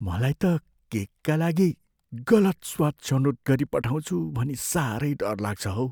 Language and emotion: Nepali, fearful